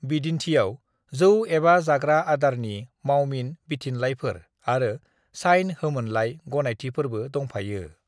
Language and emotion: Bodo, neutral